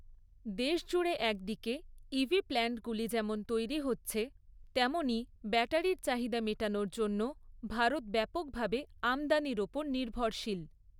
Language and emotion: Bengali, neutral